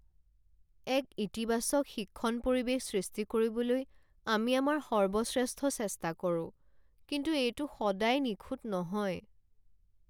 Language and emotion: Assamese, sad